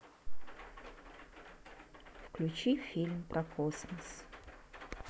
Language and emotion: Russian, neutral